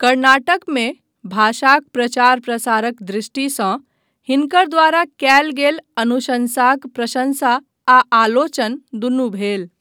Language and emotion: Maithili, neutral